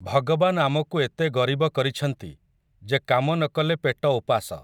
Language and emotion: Odia, neutral